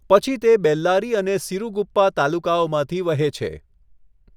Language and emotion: Gujarati, neutral